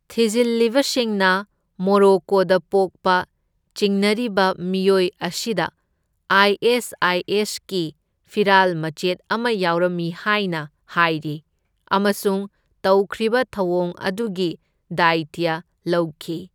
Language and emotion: Manipuri, neutral